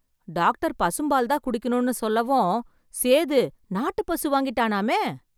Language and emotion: Tamil, surprised